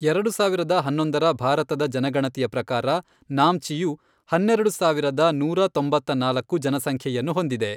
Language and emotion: Kannada, neutral